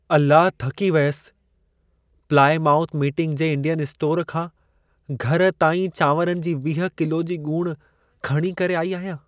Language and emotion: Sindhi, sad